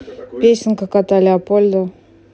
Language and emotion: Russian, neutral